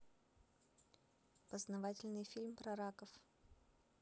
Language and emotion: Russian, neutral